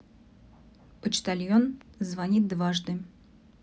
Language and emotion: Russian, neutral